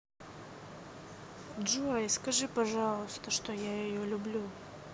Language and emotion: Russian, sad